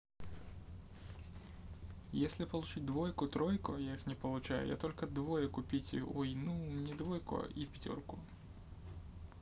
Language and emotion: Russian, neutral